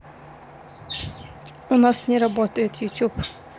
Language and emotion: Russian, neutral